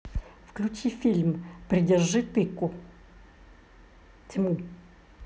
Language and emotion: Russian, neutral